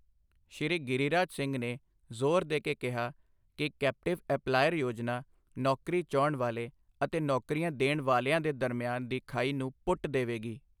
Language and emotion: Punjabi, neutral